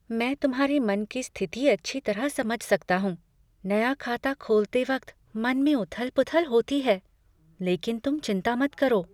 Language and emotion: Hindi, fearful